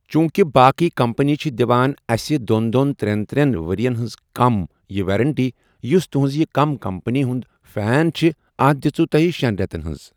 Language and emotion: Kashmiri, neutral